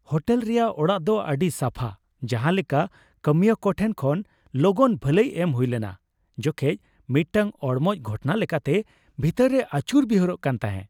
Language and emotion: Santali, happy